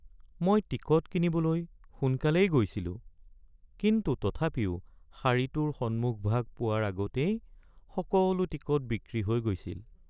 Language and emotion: Assamese, sad